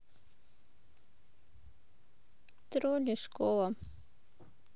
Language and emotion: Russian, neutral